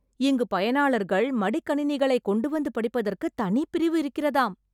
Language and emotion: Tamil, surprised